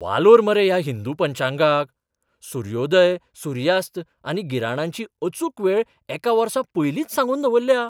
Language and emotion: Goan Konkani, surprised